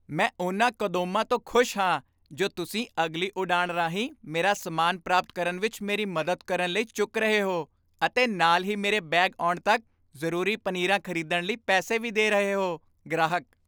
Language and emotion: Punjabi, happy